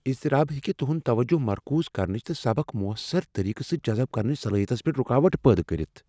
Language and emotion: Kashmiri, fearful